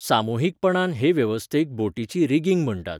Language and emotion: Goan Konkani, neutral